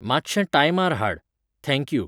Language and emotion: Goan Konkani, neutral